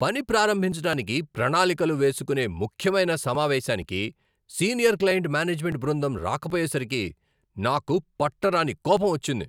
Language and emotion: Telugu, angry